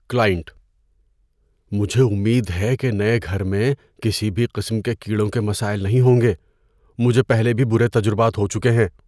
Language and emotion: Urdu, fearful